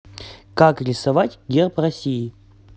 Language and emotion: Russian, positive